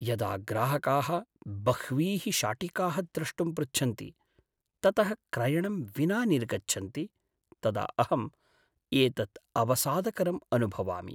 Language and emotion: Sanskrit, sad